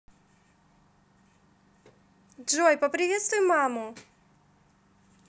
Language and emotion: Russian, positive